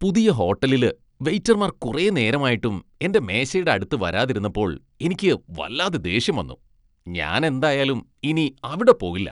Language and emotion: Malayalam, disgusted